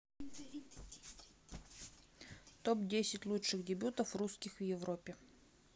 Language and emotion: Russian, neutral